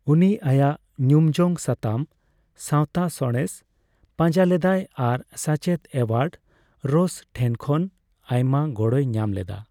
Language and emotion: Santali, neutral